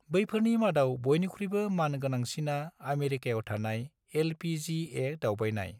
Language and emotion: Bodo, neutral